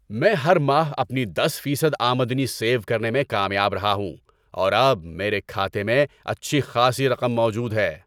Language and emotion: Urdu, happy